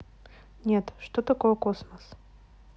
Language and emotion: Russian, neutral